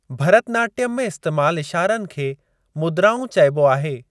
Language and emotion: Sindhi, neutral